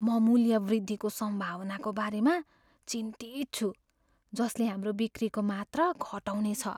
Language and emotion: Nepali, fearful